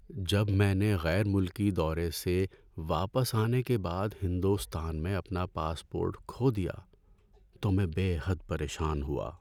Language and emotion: Urdu, sad